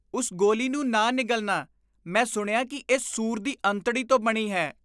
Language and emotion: Punjabi, disgusted